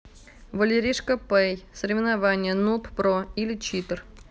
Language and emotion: Russian, neutral